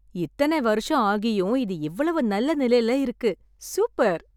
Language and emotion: Tamil, happy